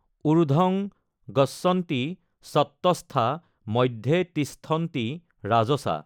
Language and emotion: Assamese, neutral